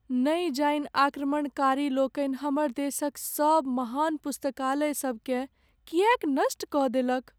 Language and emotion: Maithili, sad